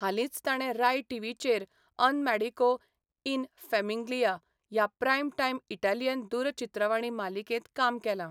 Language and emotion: Goan Konkani, neutral